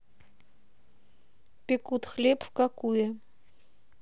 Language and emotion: Russian, neutral